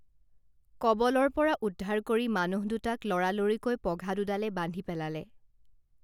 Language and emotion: Assamese, neutral